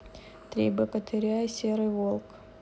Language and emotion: Russian, neutral